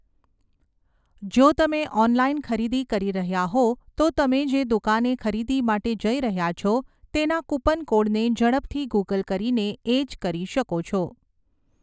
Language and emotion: Gujarati, neutral